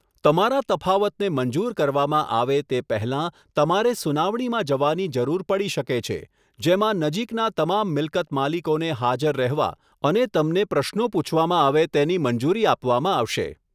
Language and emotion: Gujarati, neutral